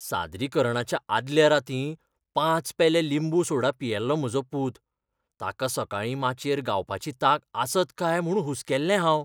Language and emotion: Goan Konkani, fearful